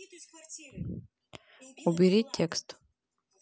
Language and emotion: Russian, neutral